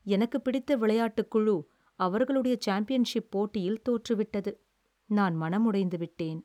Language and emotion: Tamil, sad